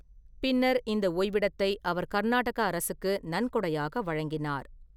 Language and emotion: Tamil, neutral